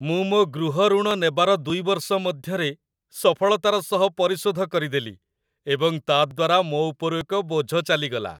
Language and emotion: Odia, happy